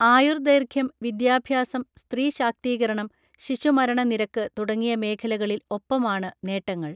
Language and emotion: Malayalam, neutral